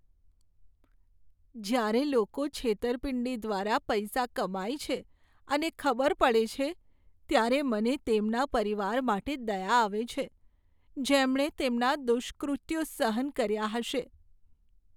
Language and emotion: Gujarati, sad